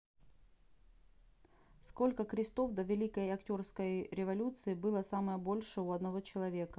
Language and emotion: Russian, neutral